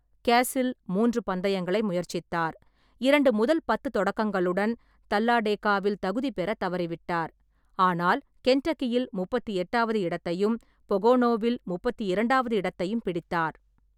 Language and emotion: Tamil, neutral